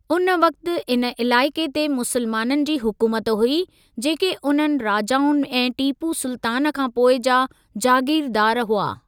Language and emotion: Sindhi, neutral